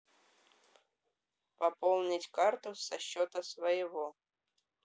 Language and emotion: Russian, neutral